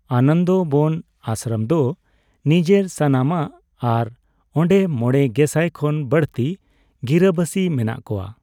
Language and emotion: Santali, neutral